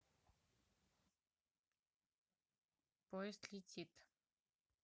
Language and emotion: Russian, neutral